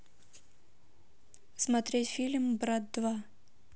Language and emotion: Russian, neutral